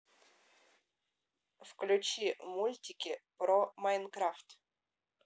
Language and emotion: Russian, neutral